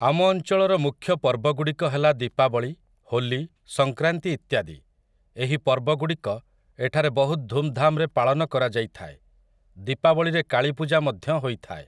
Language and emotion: Odia, neutral